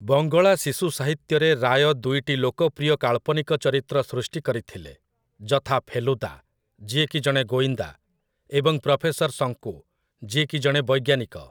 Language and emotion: Odia, neutral